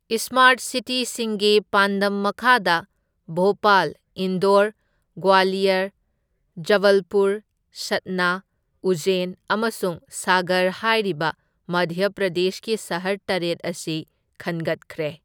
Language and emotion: Manipuri, neutral